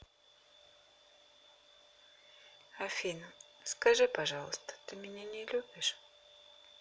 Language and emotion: Russian, sad